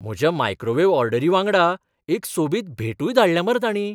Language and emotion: Goan Konkani, surprised